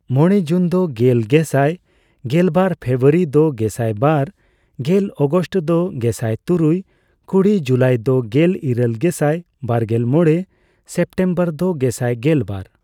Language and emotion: Santali, neutral